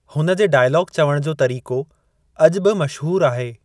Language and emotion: Sindhi, neutral